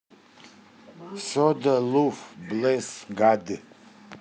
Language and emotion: Russian, neutral